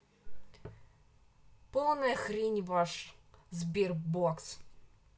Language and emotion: Russian, angry